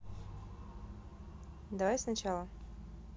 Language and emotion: Russian, neutral